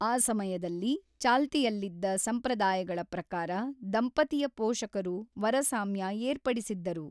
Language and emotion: Kannada, neutral